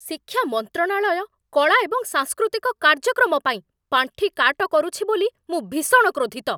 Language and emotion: Odia, angry